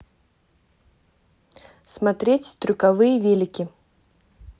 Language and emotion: Russian, neutral